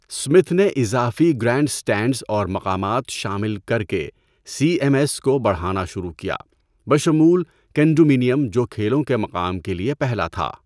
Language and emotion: Urdu, neutral